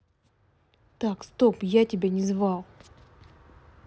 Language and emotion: Russian, angry